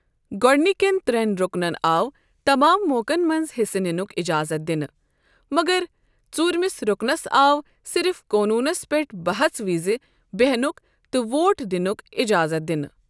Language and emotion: Kashmiri, neutral